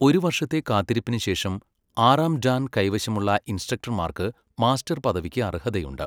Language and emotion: Malayalam, neutral